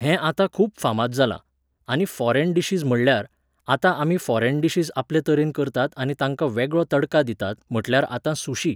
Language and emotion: Goan Konkani, neutral